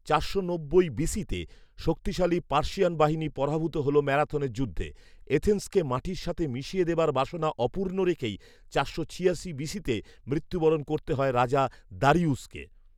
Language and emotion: Bengali, neutral